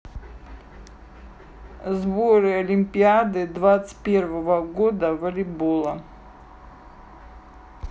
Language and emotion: Russian, neutral